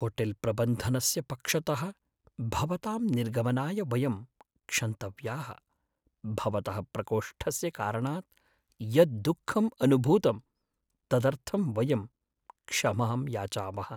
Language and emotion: Sanskrit, sad